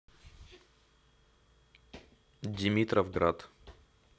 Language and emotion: Russian, neutral